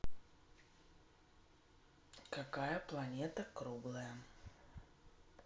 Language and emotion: Russian, neutral